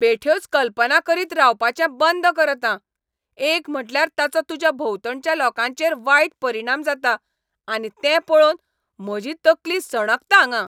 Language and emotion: Goan Konkani, angry